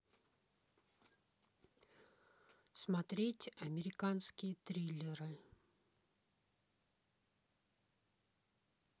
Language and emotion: Russian, neutral